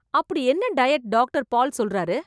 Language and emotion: Tamil, surprised